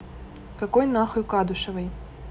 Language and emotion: Russian, angry